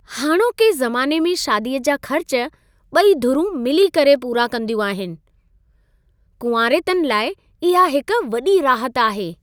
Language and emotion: Sindhi, happy